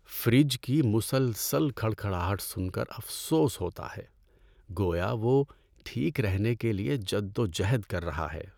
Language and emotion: Urdu, sad